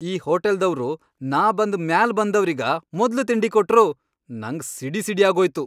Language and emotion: Kannada, angry